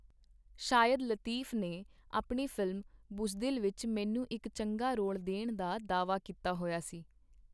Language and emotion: Punjabi, neutral